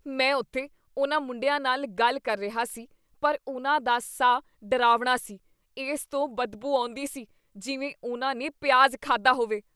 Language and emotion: Punjabi, disgusted